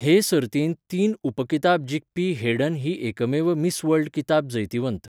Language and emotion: Goan Konkani, neutral